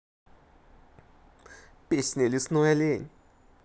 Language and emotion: Russian, positive